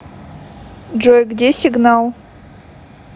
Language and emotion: Russian, neutral